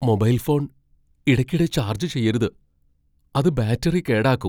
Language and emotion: Malayalam, fearful